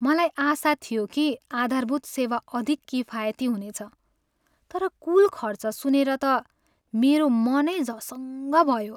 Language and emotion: Nepali, sad